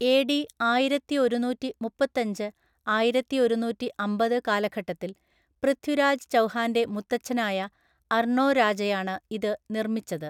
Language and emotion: Malayalam, neutral